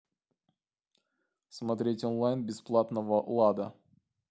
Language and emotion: Russian, neutral